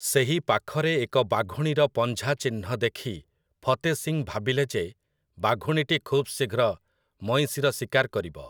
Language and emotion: Odia, neutral